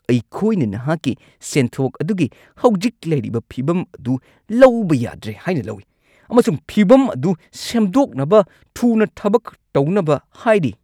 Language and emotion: Manipuri, angry